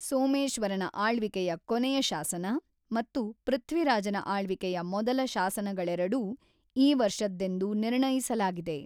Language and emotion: Kannada, neutral